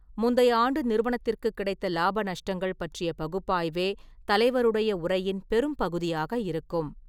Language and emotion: Tamil, neutral